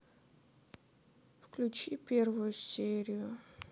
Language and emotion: Russian, sad